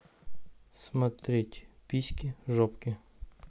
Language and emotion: Russian, neutral